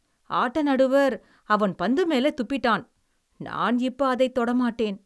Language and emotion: Tamil, disgusted